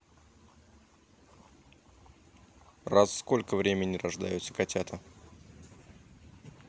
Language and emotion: Russian, neutral